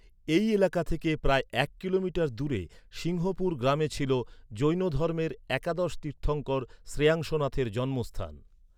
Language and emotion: Bengali, neutral